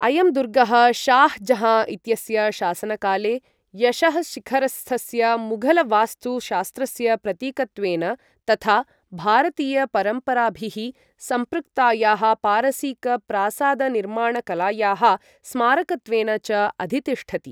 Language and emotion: Sanskrit, neutral